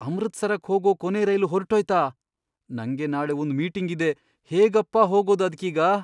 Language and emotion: Kannada, fearful